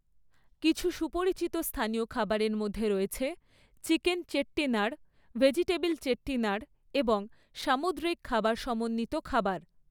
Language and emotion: Bengali, neutral